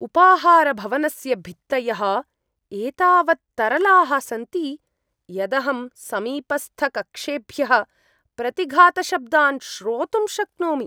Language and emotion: Sanskrit, disgusted